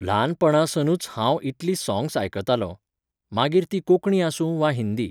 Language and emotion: Goan Konkani, neutral